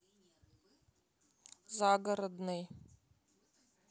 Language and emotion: Russian, neutral